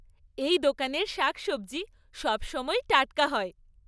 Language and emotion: Bengali, happy